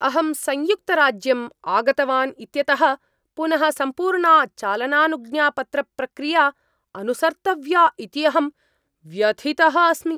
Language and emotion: Sanskrit, angry